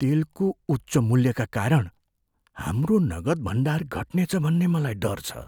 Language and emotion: Nepali, fearful